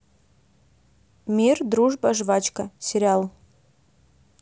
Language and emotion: Russian, neutral